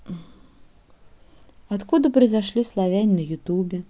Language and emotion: Russian, neutral